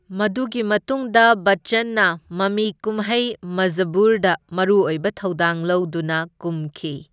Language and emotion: Manipuri, neutral